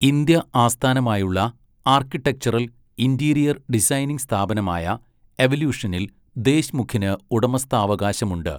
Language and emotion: Malayalam, neutral